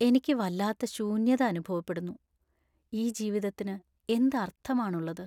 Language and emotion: Malayalam, sad